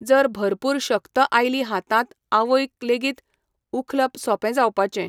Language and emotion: Goan Konkani, neutral